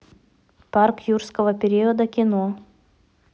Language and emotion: Russian, neutral